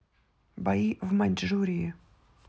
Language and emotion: Russian, neutral